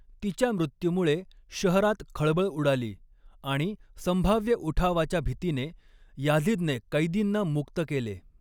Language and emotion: Marathi, neutral